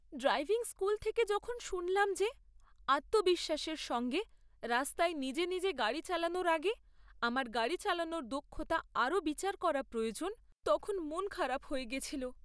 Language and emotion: Bengali, sad